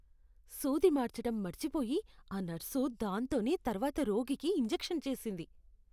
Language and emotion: Telugu, disgusted